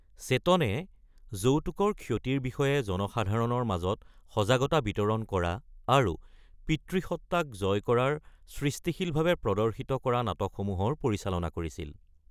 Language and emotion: Assamese, neutral